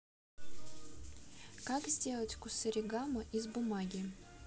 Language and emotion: Russian, neutral